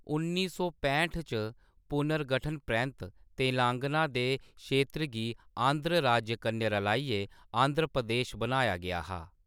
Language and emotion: Dogri, neutral